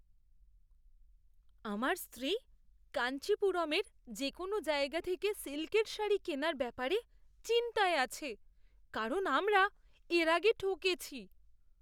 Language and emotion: Bengali, fearful